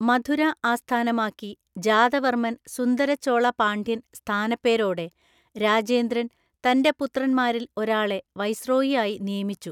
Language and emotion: Malayalam, neutral